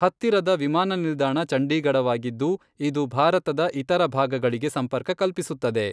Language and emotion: Kannada, neutral